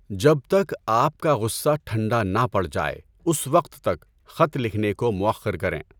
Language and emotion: Urdu, neutral